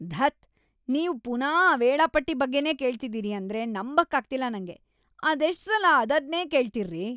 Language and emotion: Kannada, disgusted